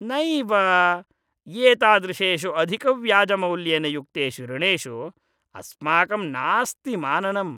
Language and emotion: Sanskrit, disgusted